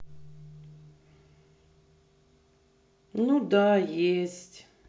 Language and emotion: Russian, sad